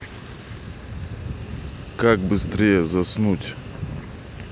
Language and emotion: Russian, neutral